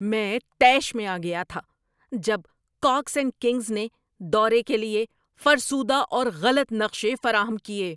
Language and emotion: Urdu, angry